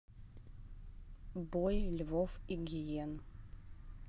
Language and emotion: Russian, neutral